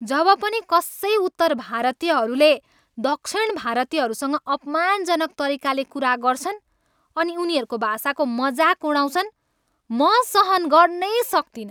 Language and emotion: Nepali, angry